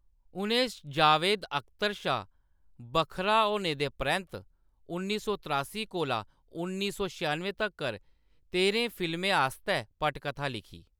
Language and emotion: Dogri, neutral